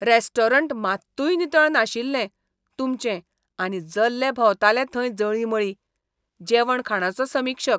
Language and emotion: Goan Konkani, disgusted